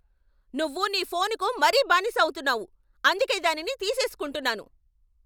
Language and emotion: Telugu, angry